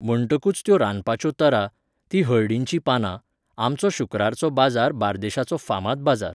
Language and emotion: Goan Konkani, neutral